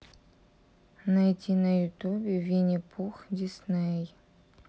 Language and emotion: Russian, sad